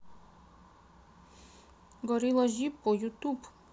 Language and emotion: Russian, neutral